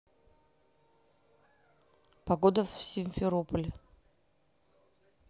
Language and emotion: Russian, neutral